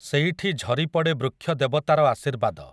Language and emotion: Odia, neutral